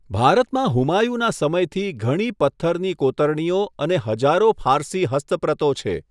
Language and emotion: Gujarati, neutral